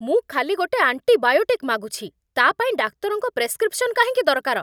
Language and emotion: Odia, angry